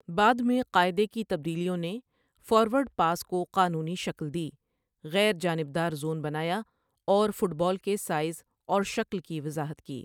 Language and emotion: Urdu, neutral